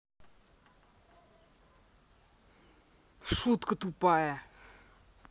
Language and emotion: Russian, angry